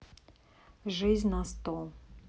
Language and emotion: Russian, neutral